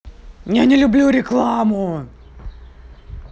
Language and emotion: Russian, angry